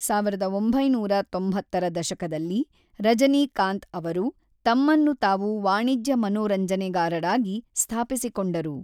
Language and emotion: Kannada, neutral